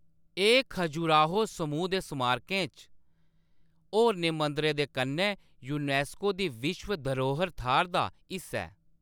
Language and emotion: Dogri, neutral